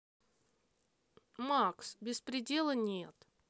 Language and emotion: Russian, angry